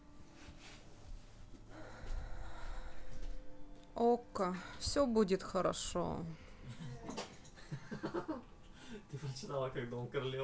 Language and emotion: Russian, sad